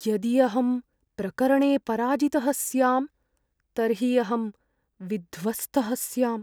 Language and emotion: Sanskrit, fearful